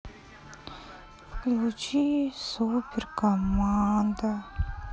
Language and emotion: Russian, sad